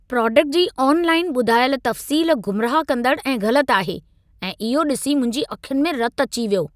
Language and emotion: Sindhi, angry